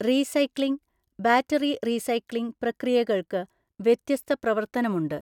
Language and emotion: Malayalam, neutral